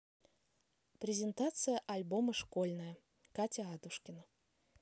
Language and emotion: Russian, neutral